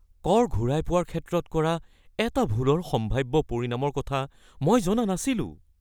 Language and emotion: Assamese, fearful